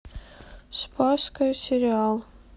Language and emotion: Russian, sad